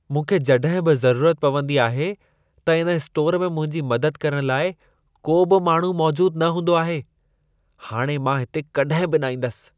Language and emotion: Sindhi, disgusted